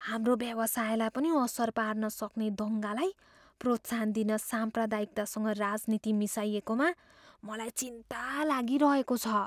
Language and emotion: Nepali, fearful